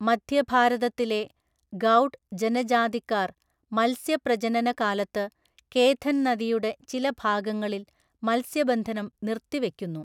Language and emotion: Malayalam, neutral